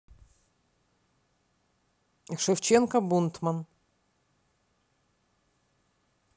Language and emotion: Russian, neutral